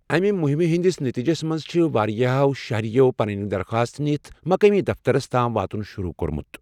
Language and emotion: Kashmiri, neutral